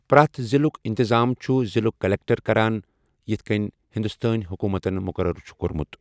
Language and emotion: Kashmiri, neutral